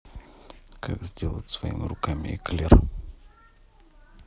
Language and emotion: Russian, neutral